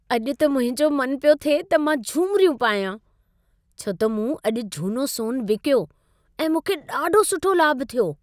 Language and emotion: Sindhi, happy